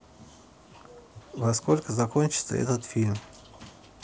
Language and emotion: Russian, neutral